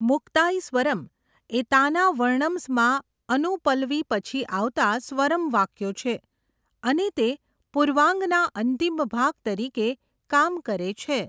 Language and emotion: Gujarati, neutral